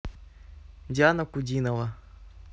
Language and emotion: Russian, neutral